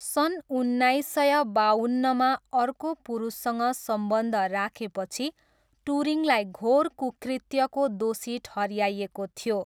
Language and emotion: Nepali, neutral